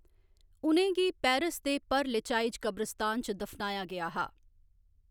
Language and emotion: Dogri, neutral